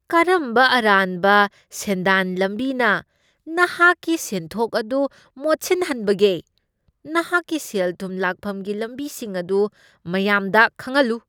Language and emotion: Manipuri, disgusted